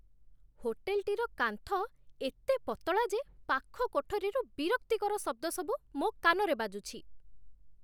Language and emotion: Odia, disgusted